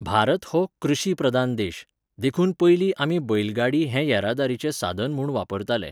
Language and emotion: Goan Konkani, neutral